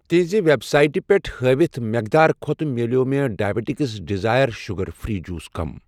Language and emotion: Kashmiri, neutral